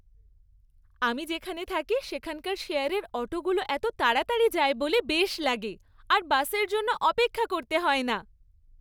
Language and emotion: Bengali, happy